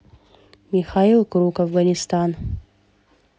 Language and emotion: Russian, neutral